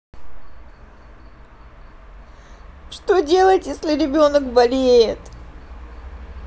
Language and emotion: Russian, sad